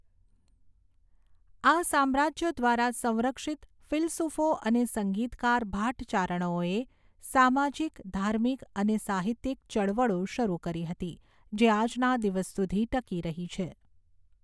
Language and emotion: Gujarati, neutral